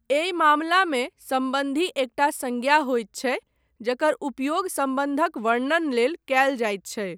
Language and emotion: Maithili, neutral